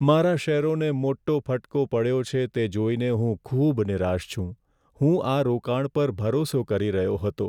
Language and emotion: Gujarati, sad